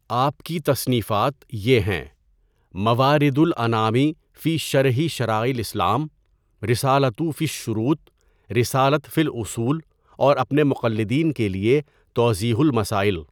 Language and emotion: Urdu, neutral